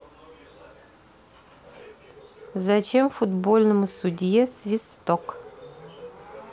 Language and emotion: Russian, neutral